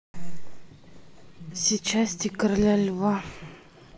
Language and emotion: Russian, sad